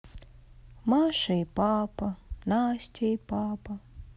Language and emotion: Russian, sad